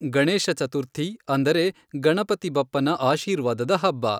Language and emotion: Kannada, neutral